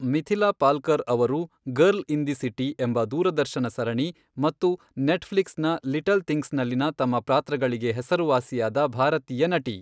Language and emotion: Kannada, neutral